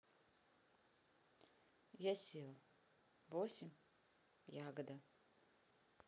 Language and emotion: Russian, neutral